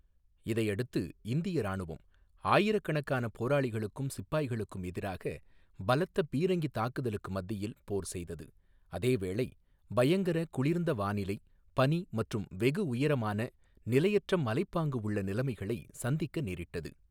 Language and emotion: Tamil, neutral